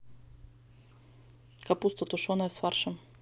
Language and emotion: Russian, neutral